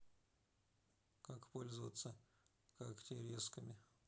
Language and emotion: Russian, neutral